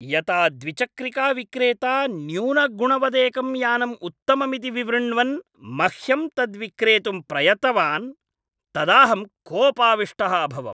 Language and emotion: Sanskrit, angry